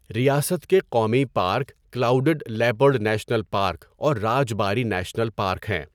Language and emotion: Urdu, neutral